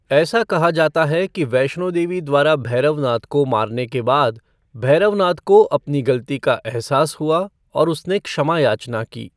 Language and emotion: Hindi, neutral